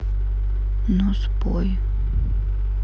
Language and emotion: Russian, sad